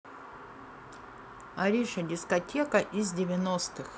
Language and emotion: Russian, neutral